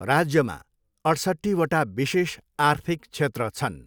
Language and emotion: Nepali, neutral